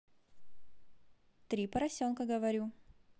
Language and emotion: Russian, positive